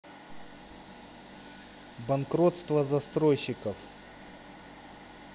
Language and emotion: Russian, neutral